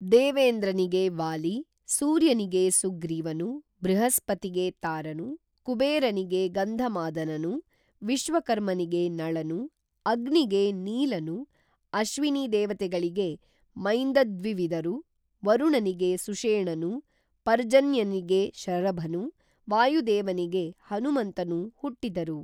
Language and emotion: Kannada, neutral